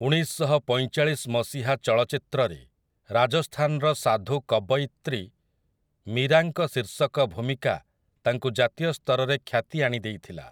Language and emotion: Odia, neutral